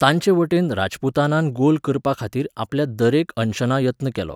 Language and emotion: Goan Konkani, neutral